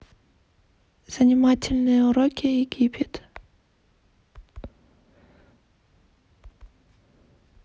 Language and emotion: Russian, neutral